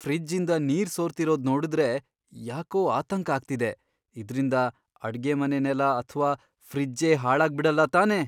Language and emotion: Kannada, fearful